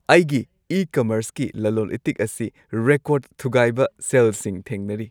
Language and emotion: Manipuri, happy